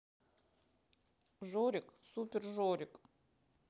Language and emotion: Russian, sad